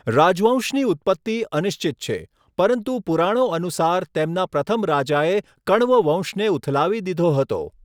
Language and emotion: Gujarati, neutral